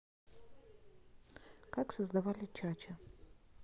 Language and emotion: Russian, neutral